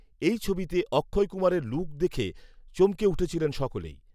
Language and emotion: Bengali, neutral